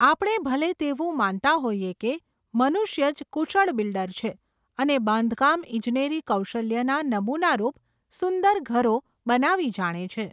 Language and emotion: Gujarati, neutral